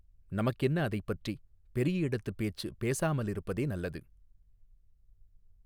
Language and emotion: Tamil, neutral